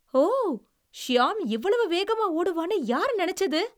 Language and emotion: Tamil, surprised